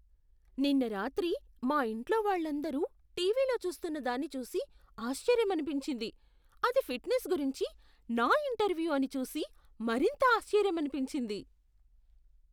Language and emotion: Telugu, surprised